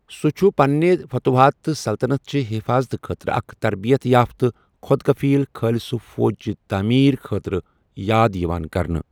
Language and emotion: Kashmiri, neutral